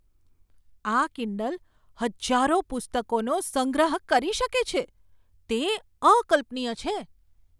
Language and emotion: Gujarati, surprised